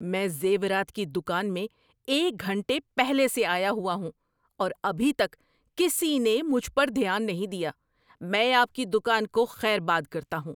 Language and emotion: Urdu, angry